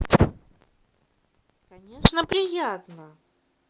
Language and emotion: Russian, positive